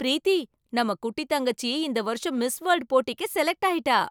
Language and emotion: Tamil, surprised